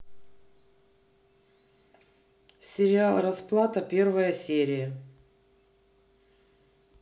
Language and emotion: Russian, neutral